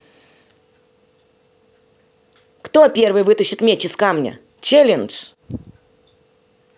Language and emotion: Russian, angry